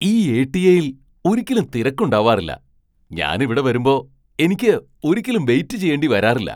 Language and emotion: Malayalam, surprised